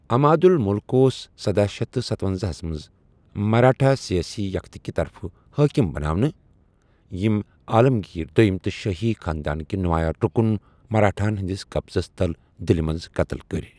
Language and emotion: Kashmiri, neutral